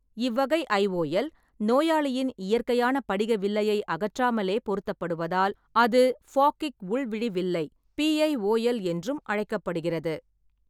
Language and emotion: Tamil, neutral